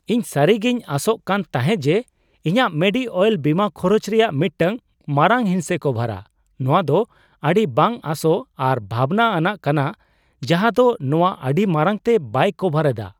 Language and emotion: Santali, surprised